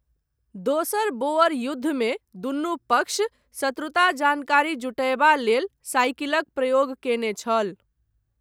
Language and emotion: Maithili, neutral